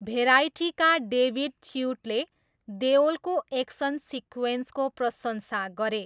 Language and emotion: Nepali, neutral